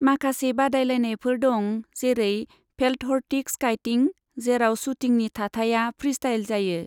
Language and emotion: Bodo, neutral